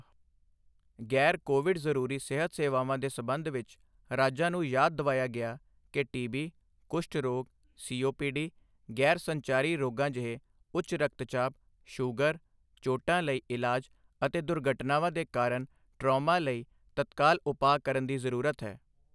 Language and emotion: Punjabi, neutral